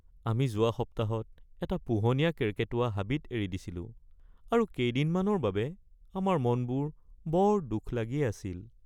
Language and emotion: Assamese, sad